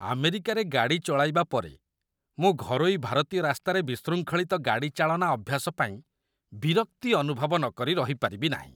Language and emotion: Odia, disgusted